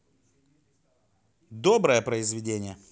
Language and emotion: Russian, positive